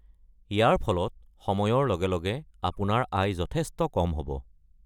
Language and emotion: Assamese, neutral